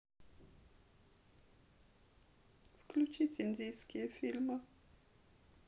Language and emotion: Russian, sad